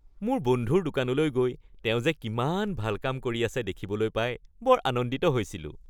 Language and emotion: Assamese, happy